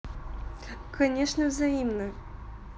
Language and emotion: Russian, positive